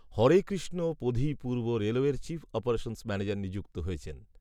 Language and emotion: Bengali, neutral